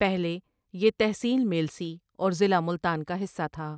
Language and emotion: Urdu, neutral